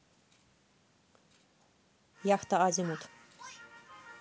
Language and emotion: Russian, neutral